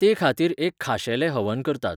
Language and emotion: Goan Konkani, neutral